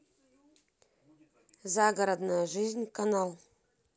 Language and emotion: Russian, neutral